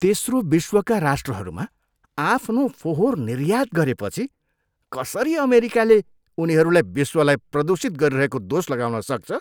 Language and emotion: Nepali, disgusted